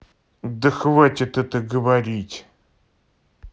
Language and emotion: Russian, angry